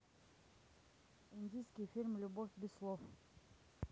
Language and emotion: Russian, neutral